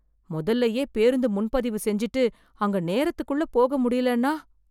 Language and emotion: Tamil, fearful